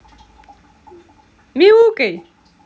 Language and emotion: Russian, positive